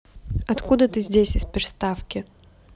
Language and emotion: Russian, neutral